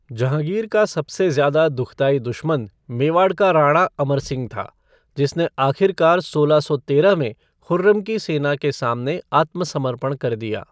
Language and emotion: Hindi, neutral